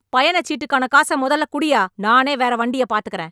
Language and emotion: Tamil, angry